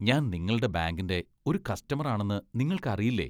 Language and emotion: Malayalam, disgusted